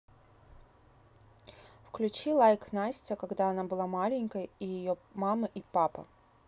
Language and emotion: Russian, neutral